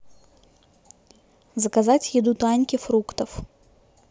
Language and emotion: Russian, neutral